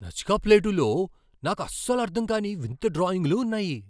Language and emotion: Telugu, surprised